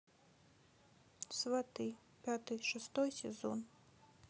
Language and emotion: Russian, sad